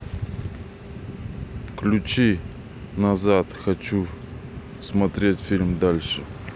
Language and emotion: Russian, neutral